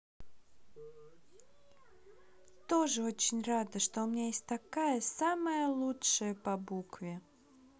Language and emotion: Russian, positive